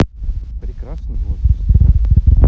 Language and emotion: Russian, neutral